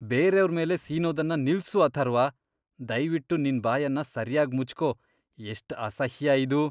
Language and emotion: Kannada, disgusted